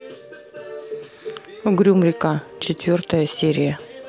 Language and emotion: Russian, neutral